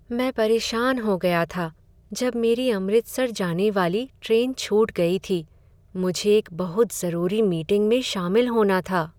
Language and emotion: Hindi, sad